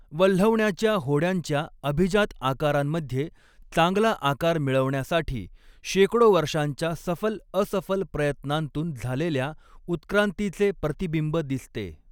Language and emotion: Marathi, neutral